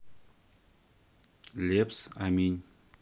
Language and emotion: Russian, neutral